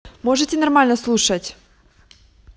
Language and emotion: Russian, angry